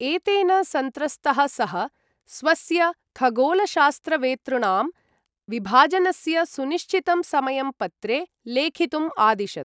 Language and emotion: Sanskrit, neutral